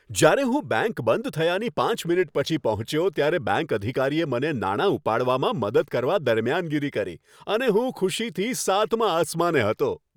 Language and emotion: Gujarati, happy